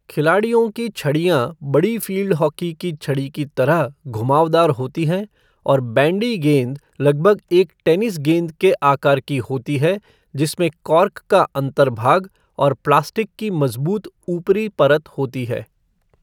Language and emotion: Hindi, neutral